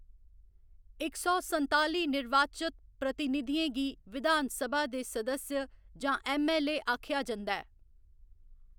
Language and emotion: Dogri, neutral